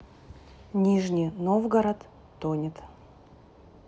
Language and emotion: Russian, neutral